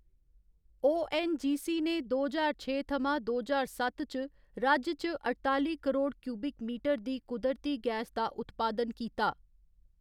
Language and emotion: Dogri, neutral